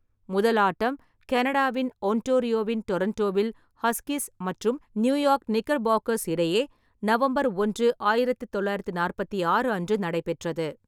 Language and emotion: Tamil, neutral